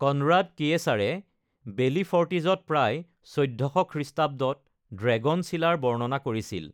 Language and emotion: Assamese, neutral